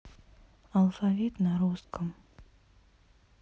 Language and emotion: Russian, neutral